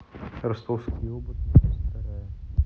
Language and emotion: Russian, neutral